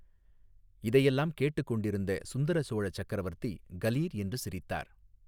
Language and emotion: Tamil, neutral